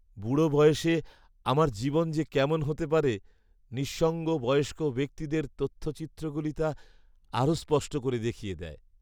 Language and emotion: Bengali, sad